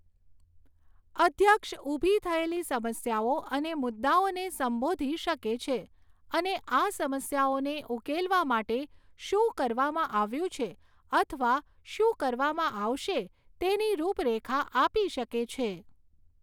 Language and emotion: Gujarati, neutral